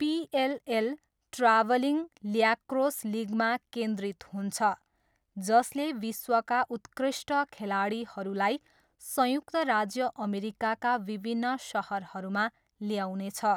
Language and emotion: Nepali, neutral